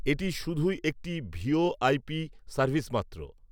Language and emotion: Bengali, neutral